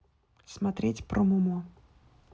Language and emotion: Russian, neutral